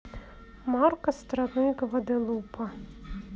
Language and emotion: Russian, neutral